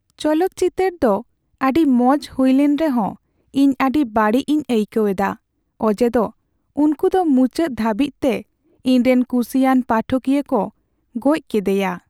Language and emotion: Santali, sad